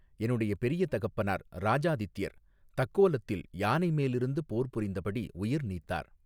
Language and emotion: Tamil, neutral